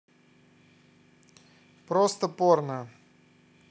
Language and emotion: Russian, neutral